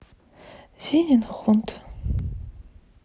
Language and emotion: Russian, sad